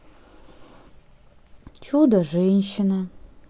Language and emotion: Russian, sad